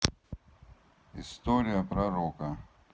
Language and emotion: Russian, neutral